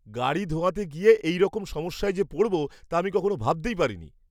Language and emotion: Bengali, surprised